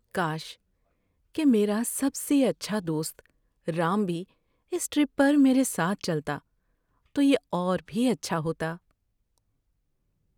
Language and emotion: Urdu, sad